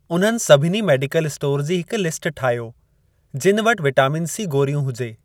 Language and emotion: Sindhi, neutral